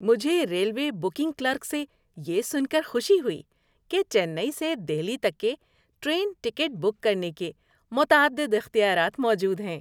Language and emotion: Urdu, happy